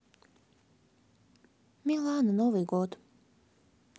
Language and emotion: Russian, sad